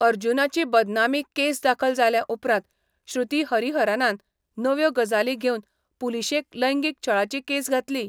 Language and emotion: Goan Konkani, neutral